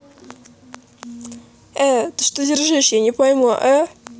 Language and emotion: Russian, neutral